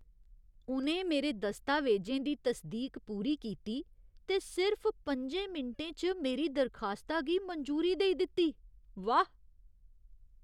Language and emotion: Dogri, surprised